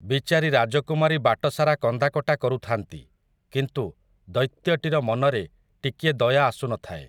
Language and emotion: Odia, neutral